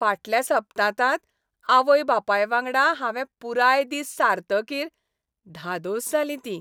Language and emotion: Goan Konkani, happy